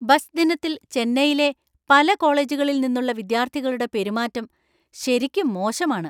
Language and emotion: Malayalam, angry